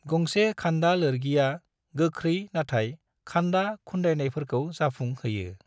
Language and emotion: Bodo, neutral